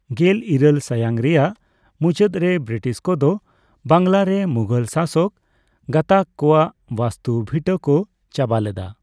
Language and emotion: Santali, neutral